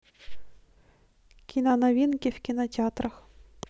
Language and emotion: Russian, neutral